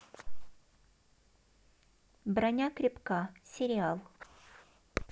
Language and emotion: Russian, neutral